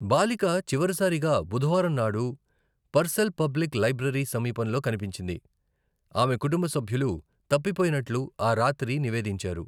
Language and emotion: Telugu, neutral